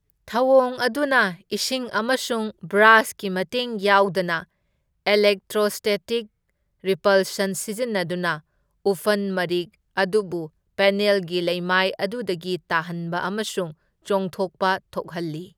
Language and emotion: Manipuri, neutral